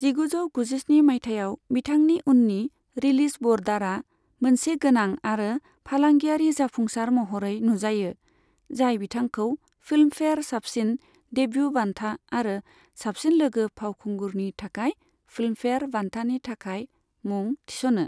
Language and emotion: Bodo, neutral